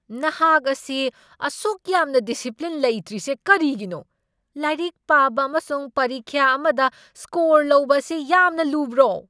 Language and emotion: Manipuri, angry